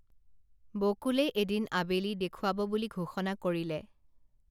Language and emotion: Assamese, neutral